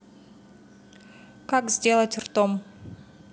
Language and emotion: Russian, neutral